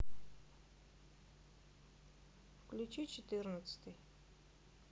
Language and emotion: Russian, neutral